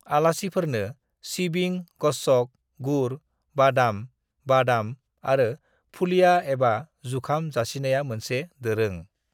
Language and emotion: Bodo, neutral